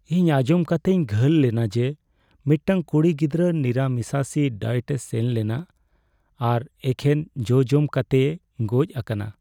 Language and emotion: Santali, sad